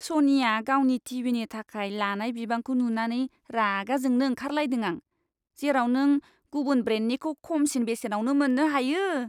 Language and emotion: Bodo, disgusted